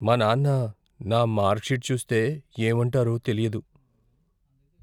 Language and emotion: Telugu, fearful